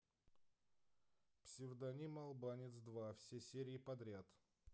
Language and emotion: Russian, neutral